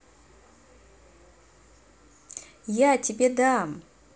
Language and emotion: Russian, positive